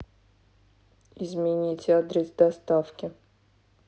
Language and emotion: Russian, neutral